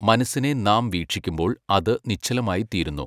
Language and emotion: Malayalam, neutral